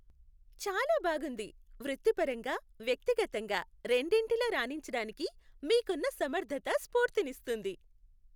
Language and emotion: Telugu, happy